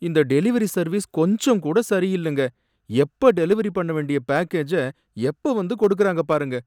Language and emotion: Tamil, sad